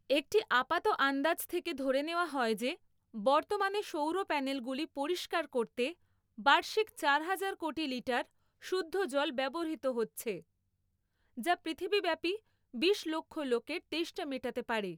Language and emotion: Bengali, neutral